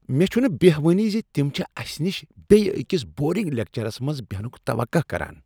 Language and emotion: Kashmiri, disgusted